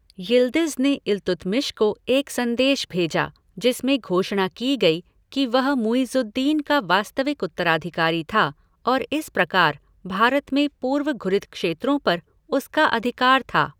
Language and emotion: Hindi, neutral